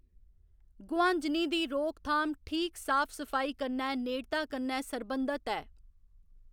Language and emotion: Dogri, neutral